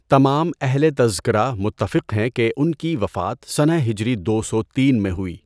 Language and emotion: Urdu, neutral